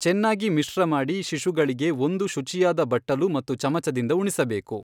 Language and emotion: Kannada, neutral